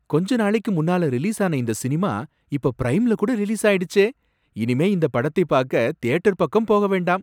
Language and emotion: Tamil, surprised